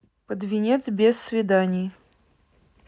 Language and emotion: Russian, neutral